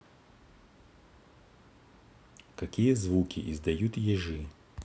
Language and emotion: Russian, neutral